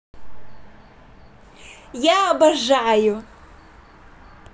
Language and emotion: Russian, positive